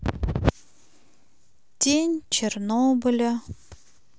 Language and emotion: Russian, sad